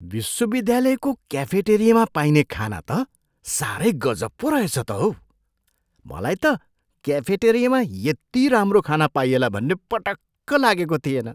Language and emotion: Nepali, surprised